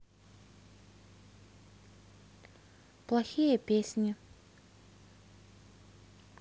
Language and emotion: Russian, neutral